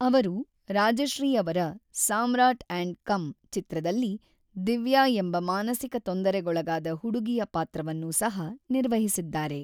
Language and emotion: Kannada, neutral